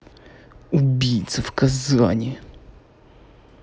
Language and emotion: Russian, angry